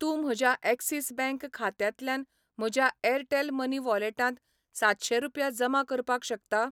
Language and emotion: Goan Konkani, neutral